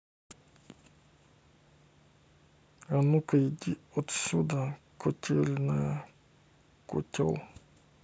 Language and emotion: Russian, neutral